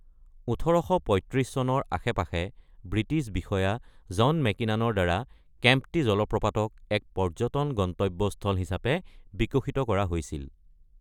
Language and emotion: Assamese, neutral